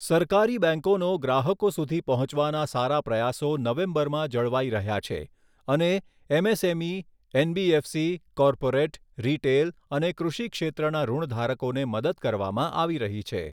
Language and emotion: Gujarati, neutral